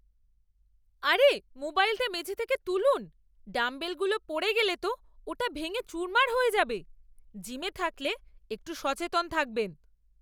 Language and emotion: Bengali, angry